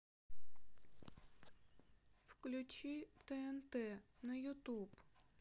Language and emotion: Russian, sad